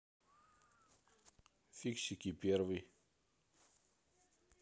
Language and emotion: Russian, neutral